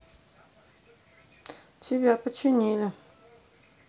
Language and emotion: Russian, neutral